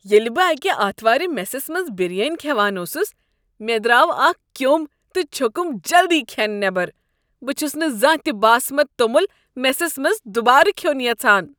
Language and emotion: Kashmiri, disgusted